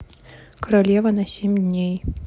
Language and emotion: Russian, neutral